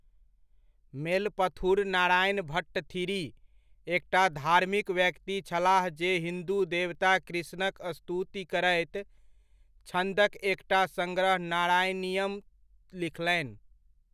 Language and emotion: Maithili, neutral